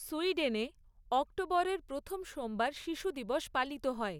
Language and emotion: Bengali, neutral